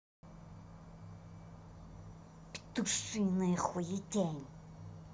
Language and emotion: Russian, angry